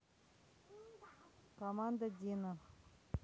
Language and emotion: Russian, neutral